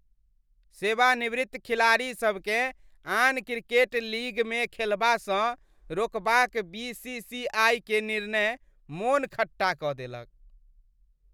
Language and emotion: Maithili, disgusted